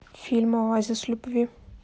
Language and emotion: Russian, neutral